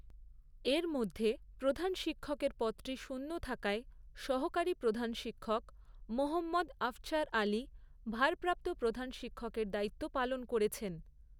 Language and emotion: Bengali, neutral